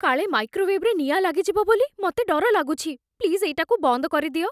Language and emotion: Odia, fearful